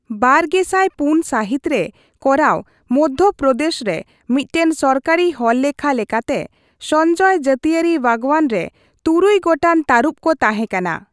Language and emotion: Santali, neutral